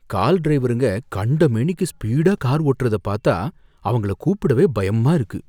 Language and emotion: Tamil, fearful